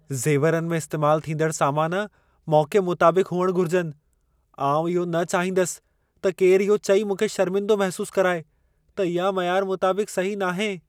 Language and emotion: Sindhi, fearful